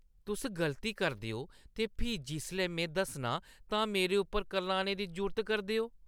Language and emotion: Dogri, disgusted